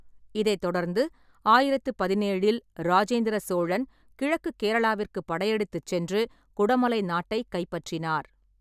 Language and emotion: Tamil, neutral